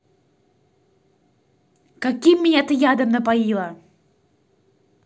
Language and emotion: Russian, angry